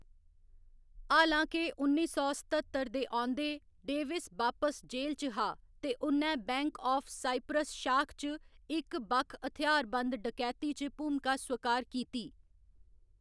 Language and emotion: Dogri, neutral